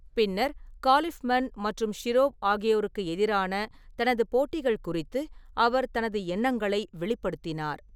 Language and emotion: Tamil, neutral